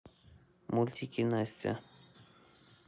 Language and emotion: Russian, neutral